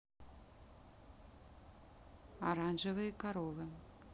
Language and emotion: Russian, neutral